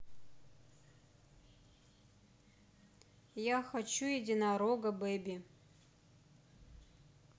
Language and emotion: Russian, neutral